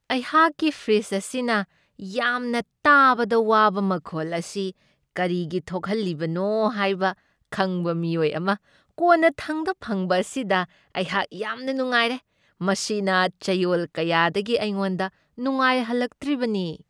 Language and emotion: Manipuri, happy